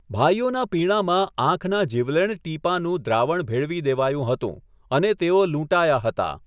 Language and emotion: Gujarati, neutral